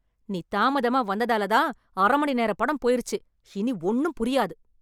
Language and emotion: Tamil, angry